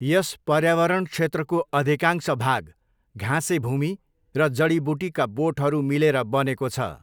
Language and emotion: Nepali, neutral